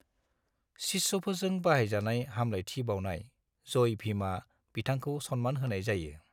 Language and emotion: Bodo, neutral